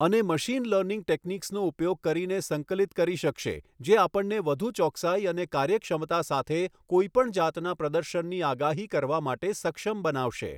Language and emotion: Gujarati, neutral